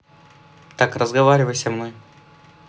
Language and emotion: Russian, neutral